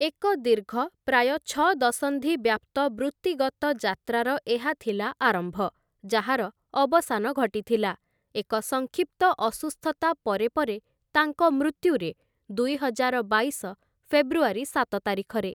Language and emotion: Odia, neutral